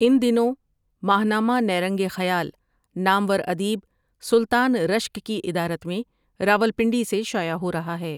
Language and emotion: Urdu, neutral